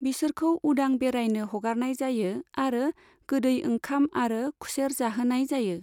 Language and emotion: Bodo, neutral